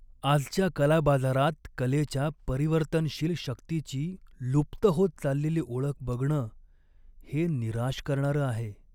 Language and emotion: Marathi, sad